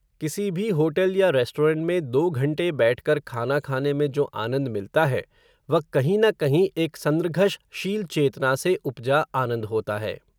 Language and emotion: Hindi, neutral